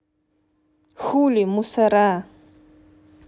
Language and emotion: Russian, neutral